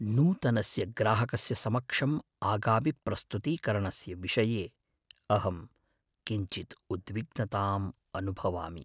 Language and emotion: Sanskrit, fearful